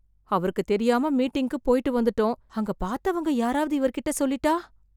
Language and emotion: Tamil, fearful